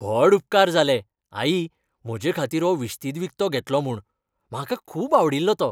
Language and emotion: Goan Konkani, happy